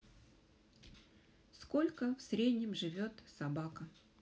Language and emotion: Russian, neutral